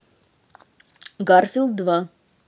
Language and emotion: Russian, neutral